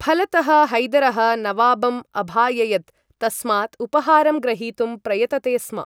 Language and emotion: Sanskrit, neutral